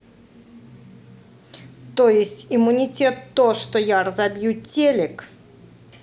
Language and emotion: Russian, angry